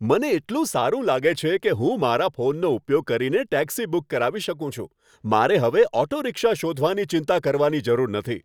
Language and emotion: Gujarati, happy